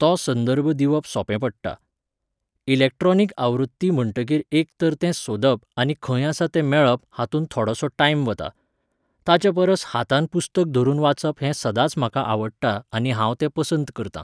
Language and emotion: Goan Konkani, neutral